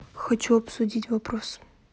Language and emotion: Russian, neutral